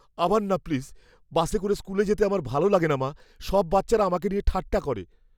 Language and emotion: Bengali, fearful